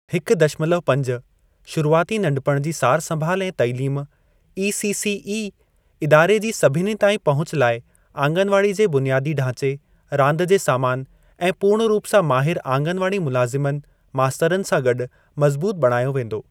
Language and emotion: Sindhi, neutral